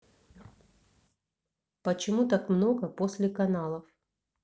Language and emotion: Russian, neutral